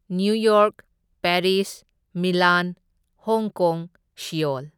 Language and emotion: Manipuri, neutral